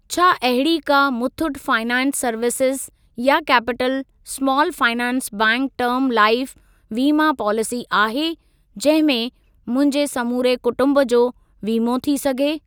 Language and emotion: Sindhi, neutral